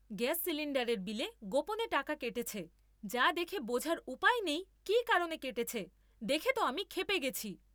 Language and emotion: Bengali, angry